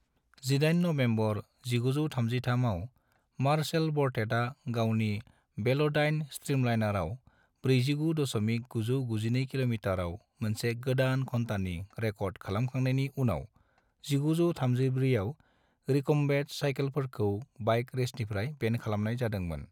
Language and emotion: Bodo, neutral